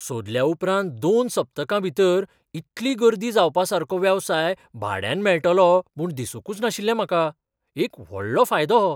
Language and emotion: Goan Konkani, surprised